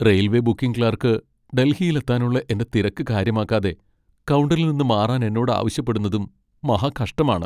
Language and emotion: Malayalam, sad